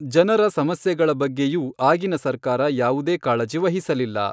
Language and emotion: Kannada, neutral